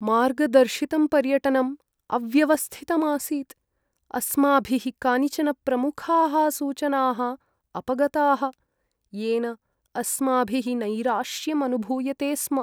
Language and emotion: Sanskrit, sad